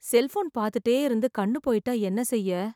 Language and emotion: Tamil, sad